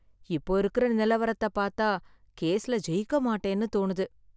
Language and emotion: Tamil, sad